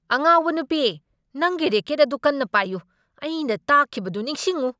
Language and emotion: Manipuri, angry